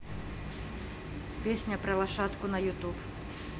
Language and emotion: Russian, neutral